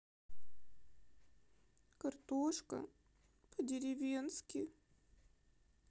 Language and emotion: Russian, sad